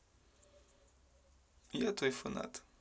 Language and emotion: Russian, neutral